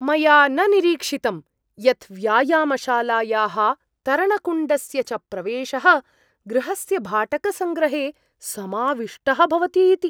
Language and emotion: Sanskrit, surprised